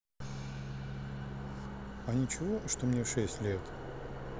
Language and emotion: Russian, neutral